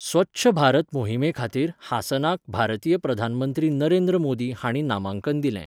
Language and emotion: Goan Konkani, neutral